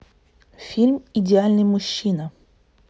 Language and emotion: Russian, neutral